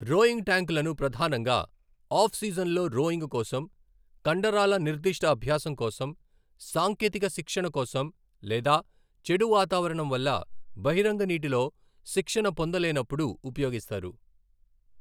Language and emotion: Telugu, neutral